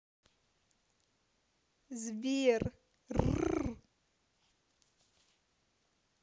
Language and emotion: Russian, positive